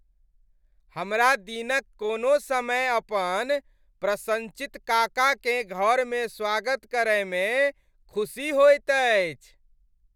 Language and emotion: Maithili, happy